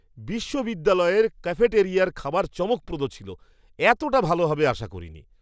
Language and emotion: Bengali, surprised